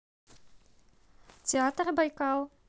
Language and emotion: Russian, neutral